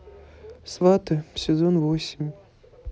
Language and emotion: Russian, neutral